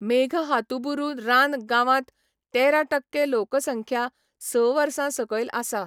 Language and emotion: Goan Konkani, neutral